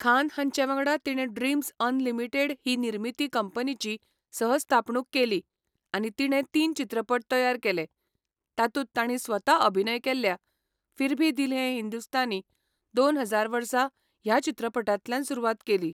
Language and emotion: Goan Konkani, neutral